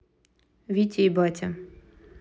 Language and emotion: Russian, neutral